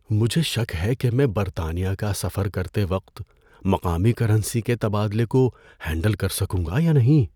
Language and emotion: Urdu, fearful